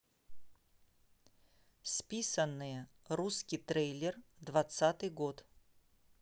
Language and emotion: Russian, neutral